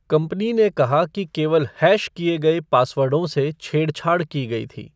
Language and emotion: Hindi, neutral